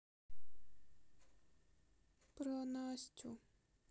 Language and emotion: Russian, sad